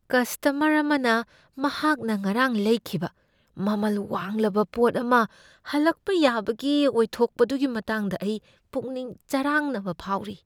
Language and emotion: Manipuri, fearful